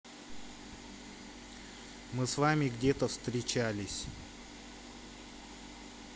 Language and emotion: Russian, neutral